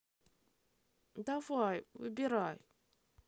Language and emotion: Russian, sad